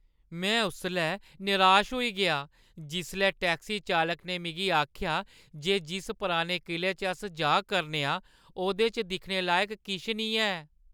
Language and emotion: Dogri, sad